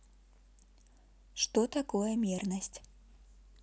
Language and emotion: Russian, neutral